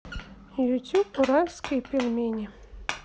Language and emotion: Russian, neutral